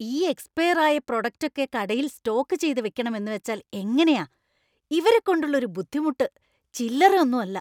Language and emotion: Malayalam, disgusted